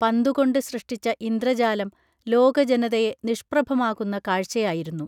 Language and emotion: Malayalam, neutral